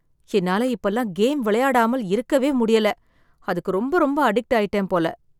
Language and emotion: Tamil, sad